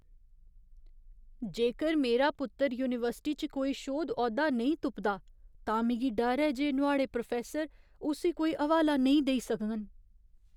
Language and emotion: Dogri, fearful